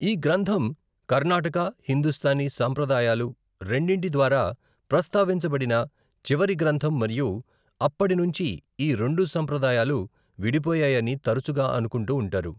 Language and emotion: Telugu, neutral